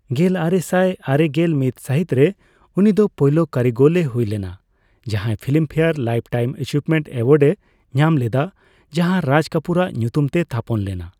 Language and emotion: Santali, neutral